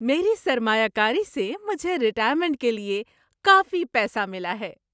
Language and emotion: Urdu, happy